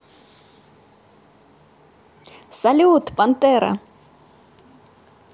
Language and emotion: Russian, positive